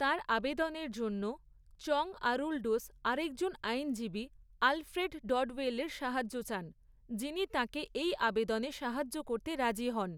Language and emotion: Bengali, neutral